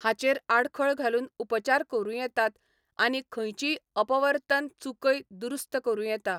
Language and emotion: Goan Konkani, neutral